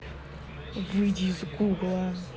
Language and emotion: Russian, angry